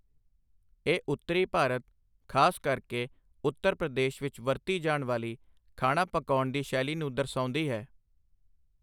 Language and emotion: Punjabi, neutral